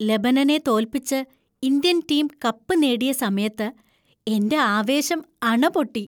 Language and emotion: Malayalam, happy